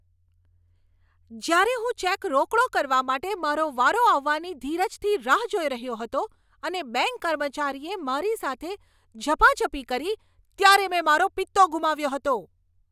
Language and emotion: Gujarati, angry